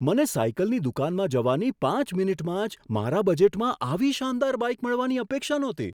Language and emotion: Gujarati, surprised